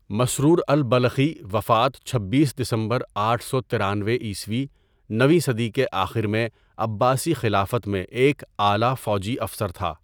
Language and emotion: Urdu, neutral